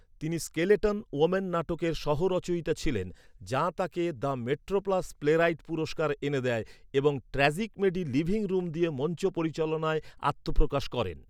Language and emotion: Bengali, neutral